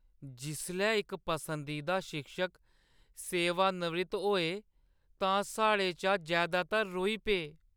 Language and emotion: Dogri, sad